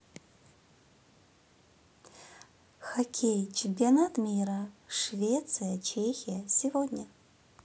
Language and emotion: Russian, neutral